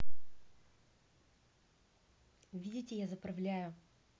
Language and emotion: Russian, neutral